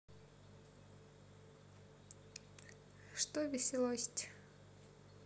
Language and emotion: Russian, neutral